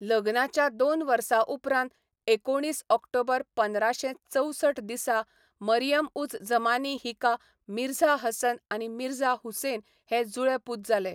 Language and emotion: Goan Konkani, neutral